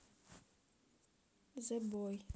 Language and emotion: Russian, neutral